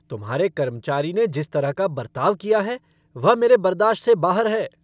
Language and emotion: Hindi, angry